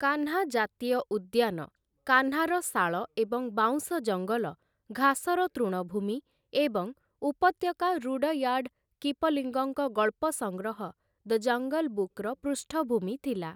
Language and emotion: Odia, neutral